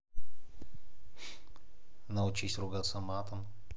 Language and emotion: Russian, neutral